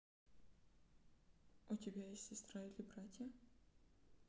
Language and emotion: Russian, neutral